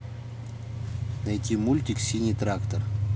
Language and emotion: Russian, neutral